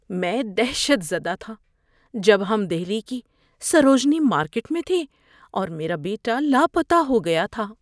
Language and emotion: Urdu, fearful